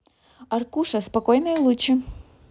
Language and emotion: Russian, positive